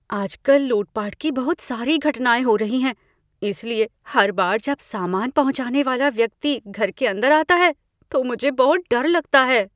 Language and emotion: Hindi, fearful